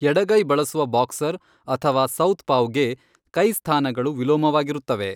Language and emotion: Kannada, neutral